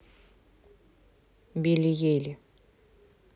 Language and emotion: Russian, neutral